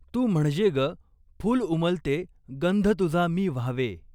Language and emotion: Marathi, neutral